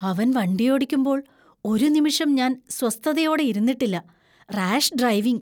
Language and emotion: Malayalam, fearful